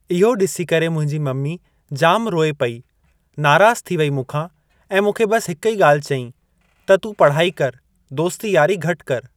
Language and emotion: Sindhi, neutral